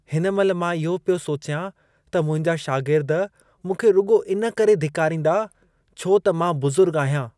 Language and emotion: Sindhi, disgusted